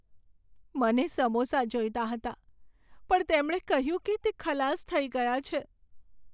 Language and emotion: Gujarati, sad